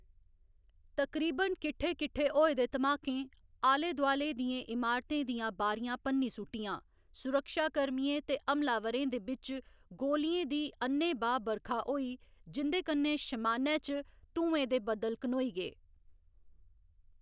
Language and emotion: Dogri, neutral